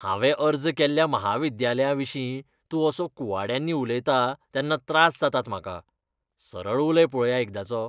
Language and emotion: Goan Konkani, disgusted